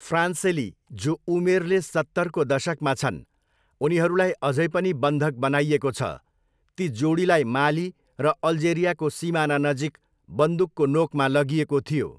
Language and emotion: Nepali, neutral